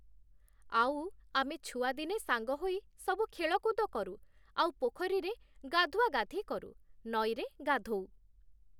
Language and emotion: Odia, neutral